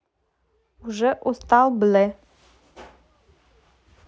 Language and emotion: Russian, neutral